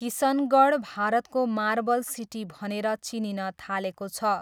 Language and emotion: Nepali, neutral